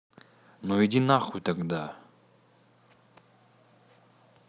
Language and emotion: Russian, angry